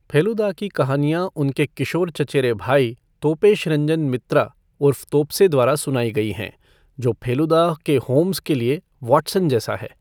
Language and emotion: Hindi, neutral